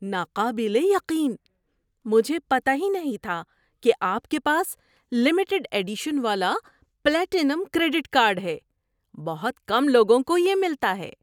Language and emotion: Urdu, surprised